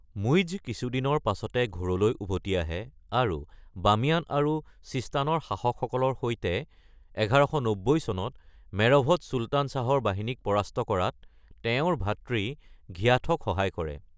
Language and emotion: Assamese, neutral